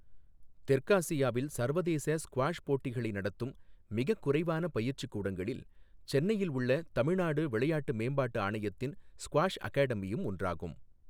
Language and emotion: Tamil, neutral